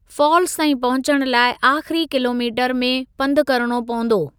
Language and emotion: Sindhi, neutral